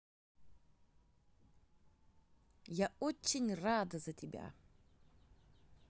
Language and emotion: Russian, positive